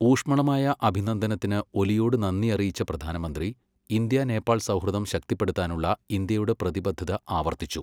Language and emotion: Malayalam, neutral